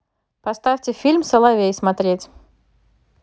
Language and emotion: Russian, neutral